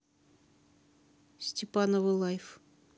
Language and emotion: Russian, neutral